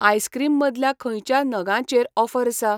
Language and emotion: Goan Konkani, neutral